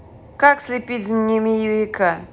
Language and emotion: Russian, neutral